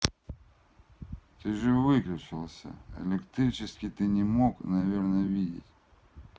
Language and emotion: Russian, neutral